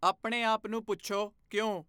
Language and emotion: Punjabi, neutral